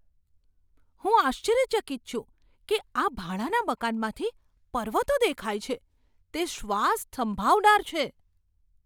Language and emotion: Gujarati, surprised